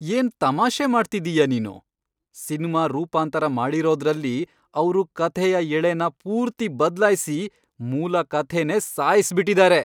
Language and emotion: Kannada, angry